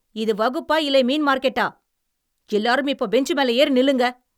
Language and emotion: Tamil, angry